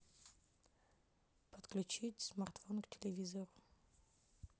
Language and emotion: Russian, neutral